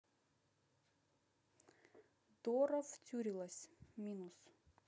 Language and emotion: Russian, neutral